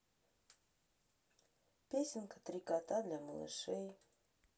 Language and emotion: Russian, sad